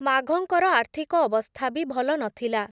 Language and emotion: Odia, neutral